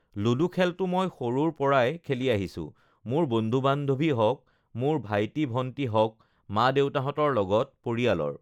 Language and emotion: Assamese, neutral